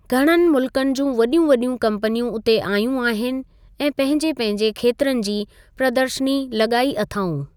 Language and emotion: Sindhi, neutral